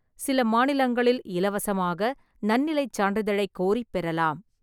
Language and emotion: Tamil, neutral